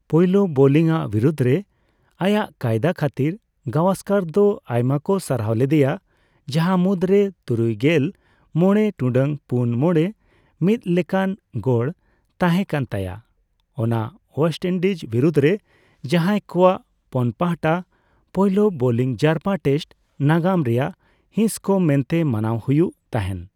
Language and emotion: Santali, neutral